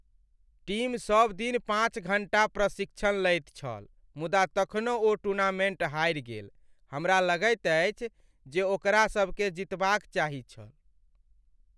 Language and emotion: Maithili, sad